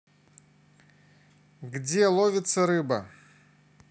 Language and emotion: Russian, neutral